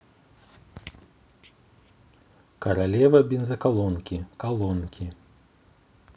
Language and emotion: Russian, neutral